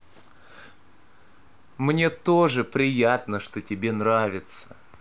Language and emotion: Russian, positive